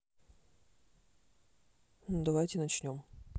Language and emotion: Russian, neutral